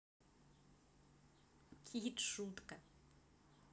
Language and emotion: Russian, positive